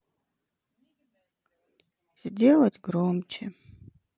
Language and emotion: Russian, sad